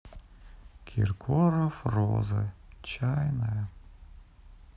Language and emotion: Russian, sad